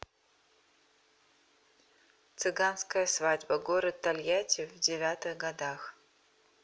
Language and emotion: Russian, neutral